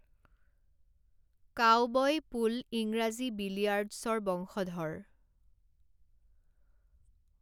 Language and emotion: Assamese, neutral